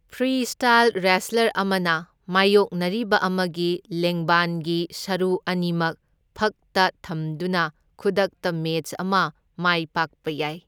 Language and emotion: Manipuri, neutral